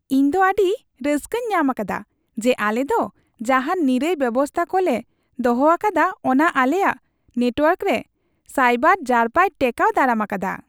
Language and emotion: Santali, happy